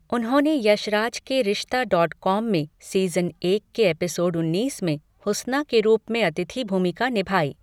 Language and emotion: Hindi, neutral